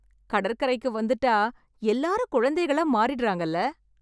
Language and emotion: Tamil, happy